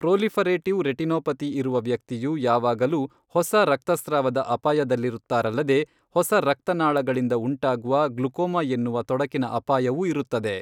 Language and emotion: Kannada, neutral